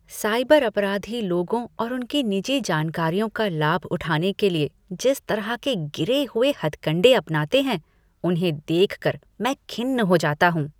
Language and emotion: Hindi, disgusted